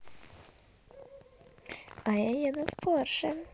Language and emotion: Russian, positive